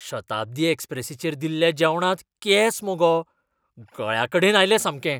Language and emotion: Goan Konkani, disgusted